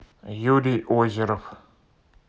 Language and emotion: Russian, neutral